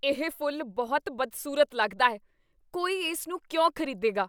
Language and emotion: Punjabi, disgusted